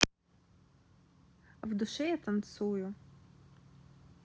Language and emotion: Russian, neutral